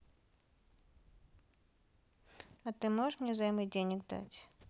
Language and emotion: Russian, neutral